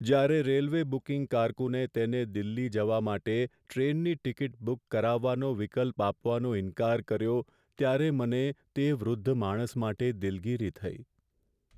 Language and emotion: Gujarati, sad